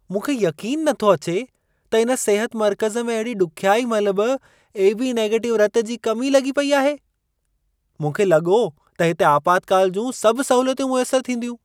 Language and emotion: Sindhi, surprised